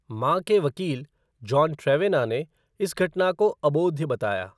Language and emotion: Hindi, neutral